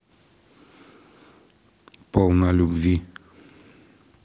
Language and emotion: Russian, neutral